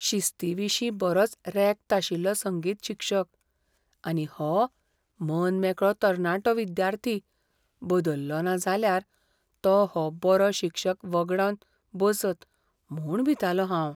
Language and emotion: Goan Konkani, fearful